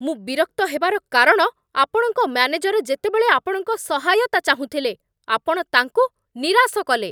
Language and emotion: Odia, angry